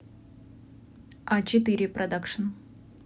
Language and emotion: Russian, neutral